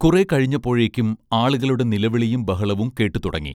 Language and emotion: Malayalam, neutral